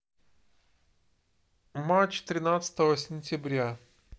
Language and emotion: Russian, neutral